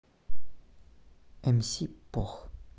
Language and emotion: Russian, neutral